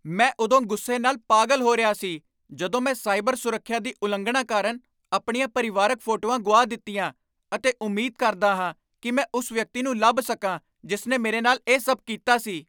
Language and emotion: Punjabi, angry